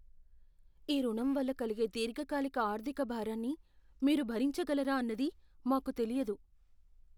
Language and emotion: Telugu, fearful